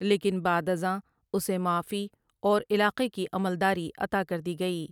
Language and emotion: Urdu, neutral